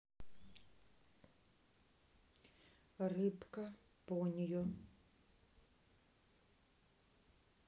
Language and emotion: Russian, neutral